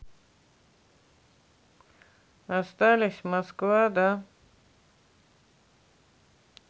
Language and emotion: Russian, neutral